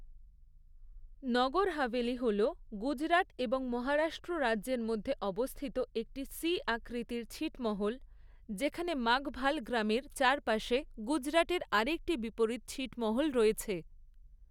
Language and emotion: Bengali, neutral